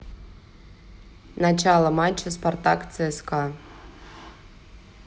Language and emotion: Russian, neutral